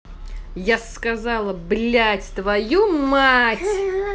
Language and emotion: Russian, angry